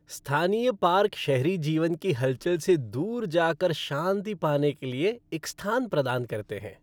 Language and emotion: Hindi, happy